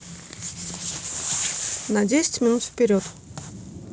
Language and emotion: Russian, neutral